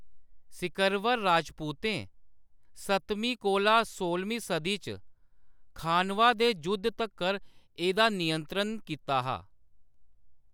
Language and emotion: Dogri, neutral